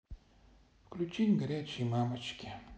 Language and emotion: Russian, sad